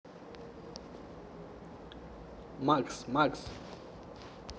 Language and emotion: Russian, positive